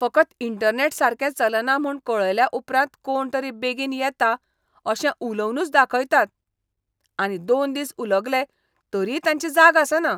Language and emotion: Goan Konkani, disgusted